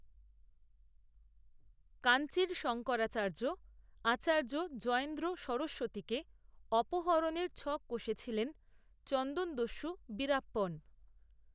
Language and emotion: Bengali, neutral